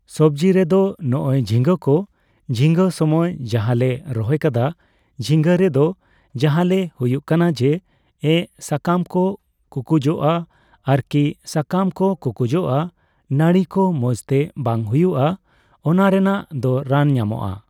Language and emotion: Santali, neutral